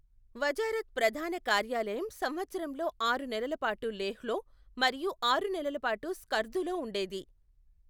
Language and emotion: Telugu, neutral